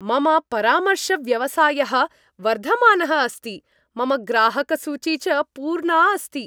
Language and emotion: Sanskrit, happy